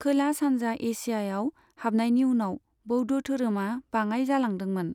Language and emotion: Bodo, neutral